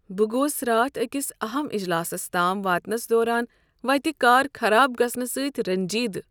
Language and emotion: Kashmiri, sad